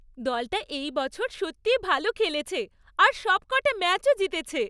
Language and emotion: Bengali, happy